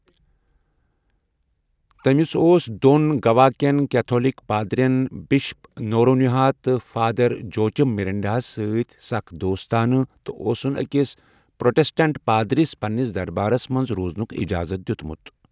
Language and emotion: Kashmiri, neutral